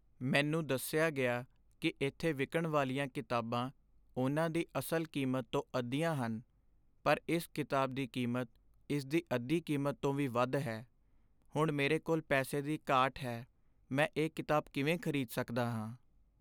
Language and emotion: Punjabi, sad